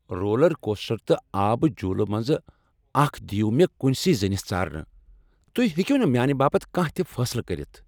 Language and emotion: Kashmiri, angry